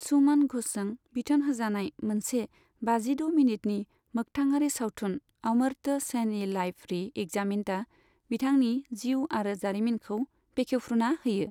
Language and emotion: Bodo, neutral